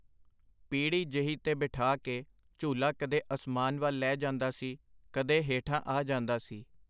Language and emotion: Punjabi, neutral